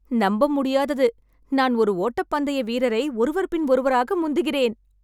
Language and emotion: Tamil, happy